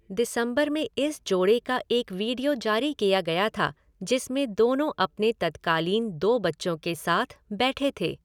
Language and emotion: Hindi, neutral